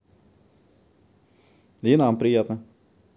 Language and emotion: Russian, neutral